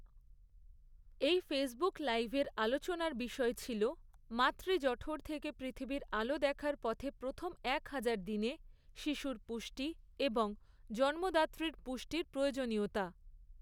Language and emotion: Bengali, neutral